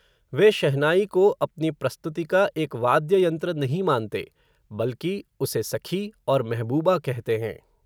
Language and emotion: Hindi, neutral